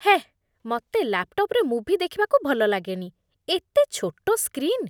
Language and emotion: Odia, disgusted